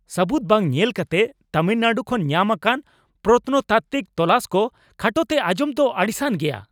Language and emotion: Santali, angry